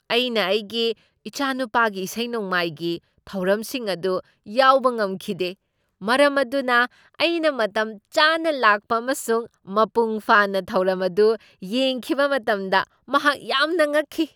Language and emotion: Manipuri, surprised